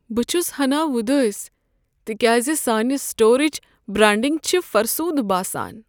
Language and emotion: Kashmiri, sad